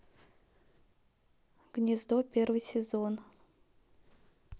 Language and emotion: Russian, neutral